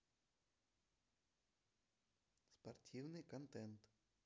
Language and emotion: Russian, neutral